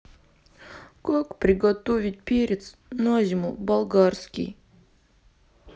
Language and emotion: Russian, sad